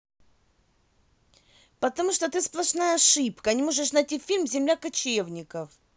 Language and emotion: Russian, angry